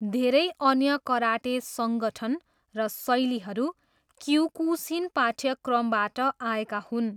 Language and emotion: Nepali, neutral